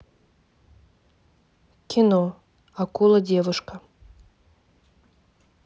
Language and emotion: Russian, neutral